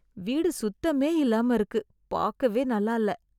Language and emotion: Tamil, disgusted